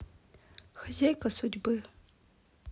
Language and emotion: Russian, sad